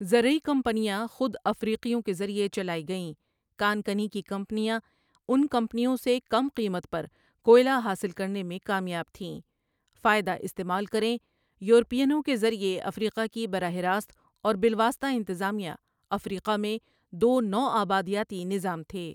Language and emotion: Urdu, neutral